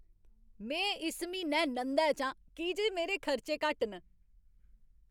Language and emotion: Dogri, happy